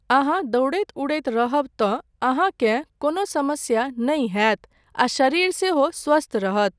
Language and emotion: Maithili, neutral